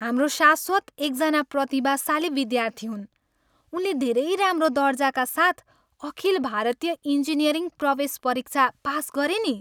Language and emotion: Nepali, happy